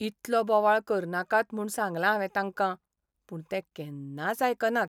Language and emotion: Goan Konkani, sad